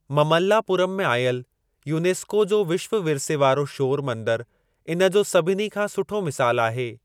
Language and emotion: Sindhi, neutral